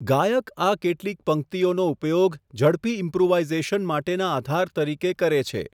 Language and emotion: Gujarati, neutral